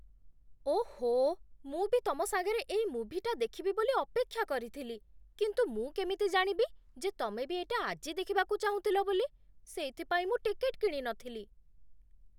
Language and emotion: Odia, surprised